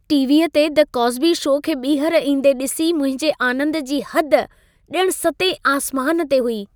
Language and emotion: Sindhi, happy